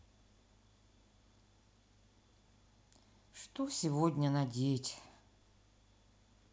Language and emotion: Russian, sad